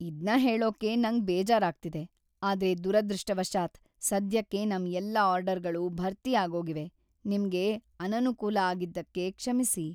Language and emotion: Kannada, sad